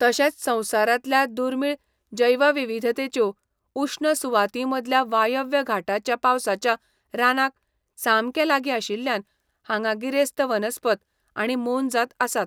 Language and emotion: Goan Konkani, neutral